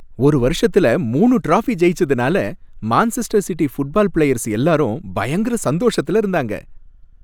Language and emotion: Tamil, happy